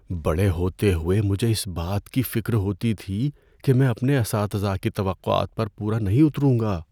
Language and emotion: Urdu, fearful